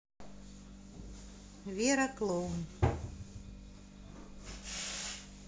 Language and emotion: Russian, neutral